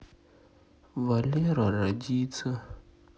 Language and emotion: Russian, sad